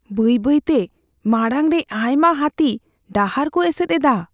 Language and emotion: Santali, fearful